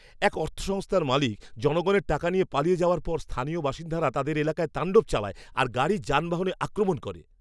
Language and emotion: Bengali, angry